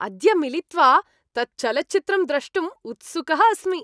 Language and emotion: Sanskrit, happy